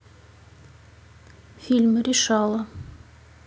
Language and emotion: Russian, neutral